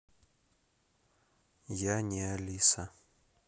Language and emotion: Russian, neutral